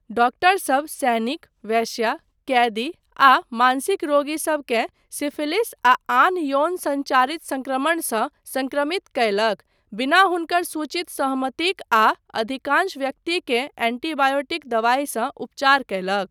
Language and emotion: Maithili, neutral